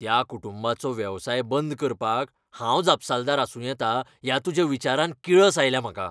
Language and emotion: Goan Konkani, angry